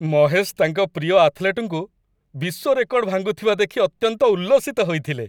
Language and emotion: Odia, happy